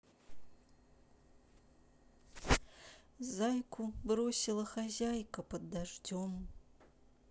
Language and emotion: Russian, sad